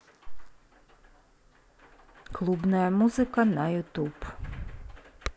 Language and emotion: Russian, neutral